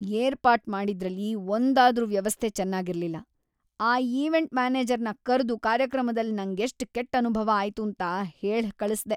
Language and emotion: Kannada, disgusted